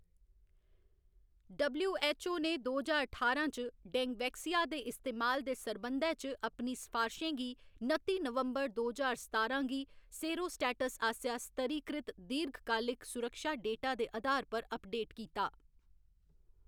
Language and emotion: Dogri, neutral